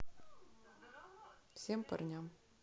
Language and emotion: Russian, neutral